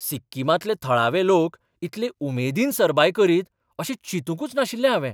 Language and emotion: Goan Konkani, surprised